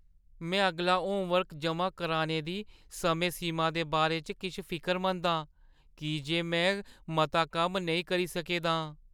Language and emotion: Dogri, fearful